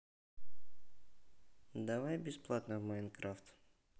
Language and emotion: Russian, neutral